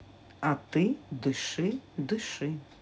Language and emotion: Russian, neutral